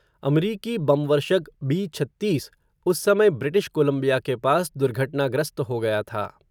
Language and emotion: Hindi, neutral